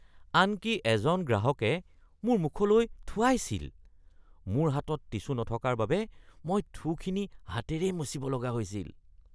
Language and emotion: Assamese, disgusted